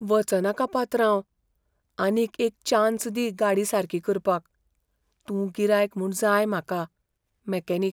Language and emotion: Goan Konkani, fearful